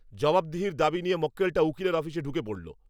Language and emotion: Bengali, angry